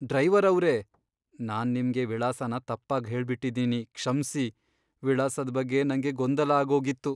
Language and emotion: Kannada, sad